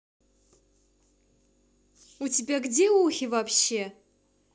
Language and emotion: Russian, neutral